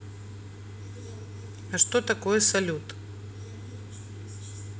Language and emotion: Russian, neutral